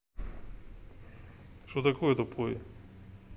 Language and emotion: Russian, neutral